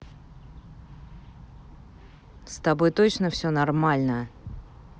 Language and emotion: Russian, angry